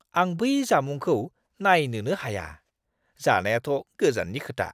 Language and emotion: Bodo, disgusted